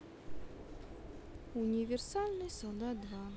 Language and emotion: Russian, sad